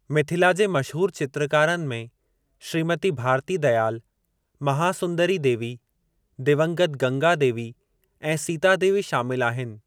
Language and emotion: Sindhi, neutral